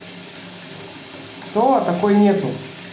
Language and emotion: Russian, neutral